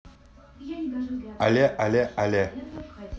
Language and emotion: Russian, positive